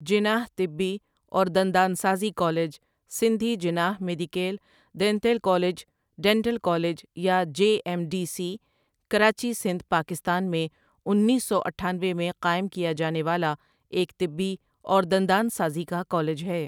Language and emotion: Urdu, neutral